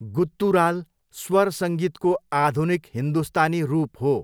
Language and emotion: Nepali, neutral